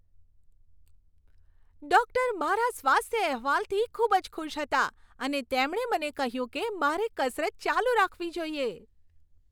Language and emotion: Gujarati, happy